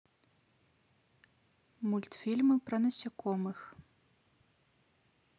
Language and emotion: Russian, neutral